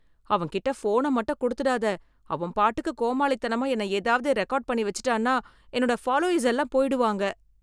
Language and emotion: Tamil, fearful